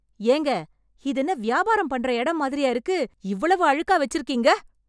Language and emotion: Tamil, angry